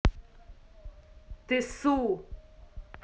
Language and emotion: Russian, angry